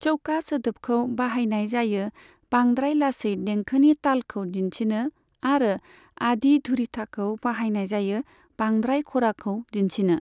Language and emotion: Bodo, neutral